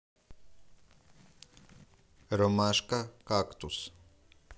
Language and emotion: Russian, neutral